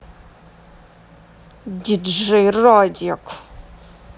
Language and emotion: Russian, angry